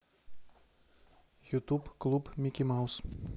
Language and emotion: Russian, neutral